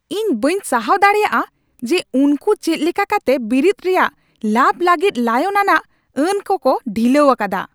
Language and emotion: Santali, angry